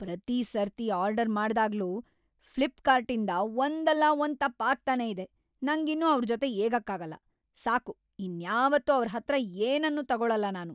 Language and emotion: Kannada, angry